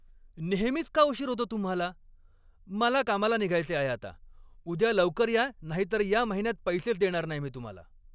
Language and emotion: Marathi, angry